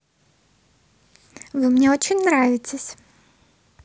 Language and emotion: Russian, positive